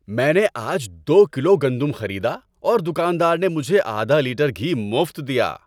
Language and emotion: Urdu, happy